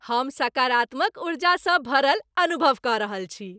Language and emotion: Maithili, happy